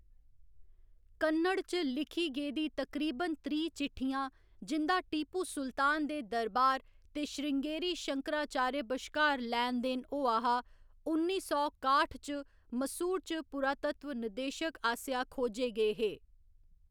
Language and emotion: Dogri, neutral